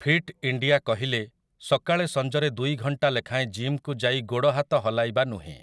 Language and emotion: Odia, neutral